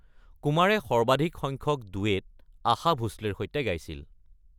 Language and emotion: Assamese, neutral